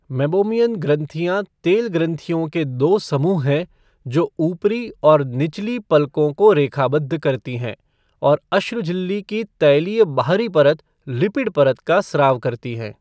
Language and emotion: Hindi, neutral